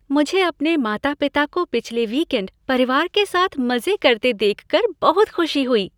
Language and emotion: Hindi, happy